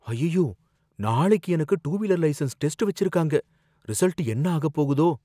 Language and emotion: Tamil, fearful